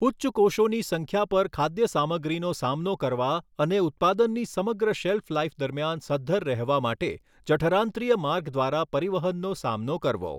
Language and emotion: Gujarati, neutral